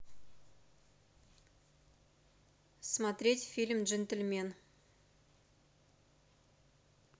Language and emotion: Russian, neutral